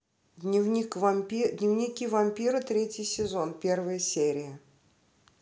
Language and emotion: Russian, neutral